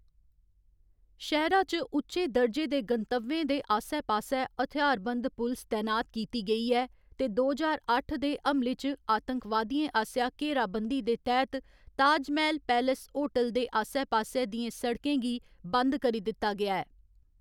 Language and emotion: Dogri, neutral